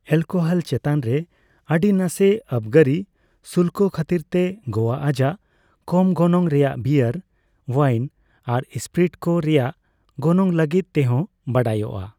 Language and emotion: Santali, neutral